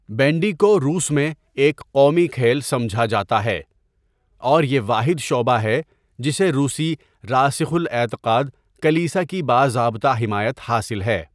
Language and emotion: Urdu, neutral